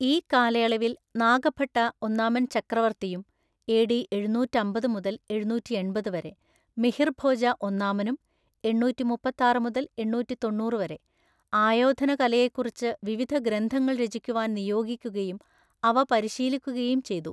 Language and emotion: Malayalam, neutral